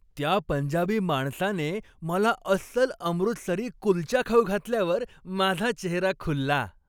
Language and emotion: Marathi, happy